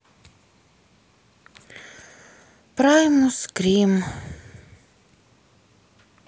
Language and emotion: Russian, sad